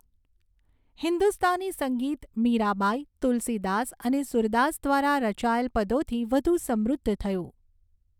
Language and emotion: Gujarati, neutral